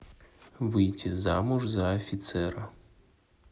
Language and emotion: Russian, neutral